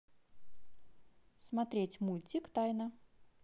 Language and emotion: Russian, neutral